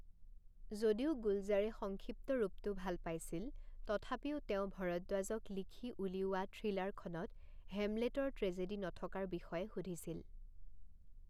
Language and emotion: Assamese, neutral